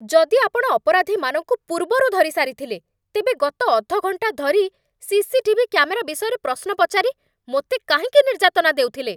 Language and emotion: Odia, angry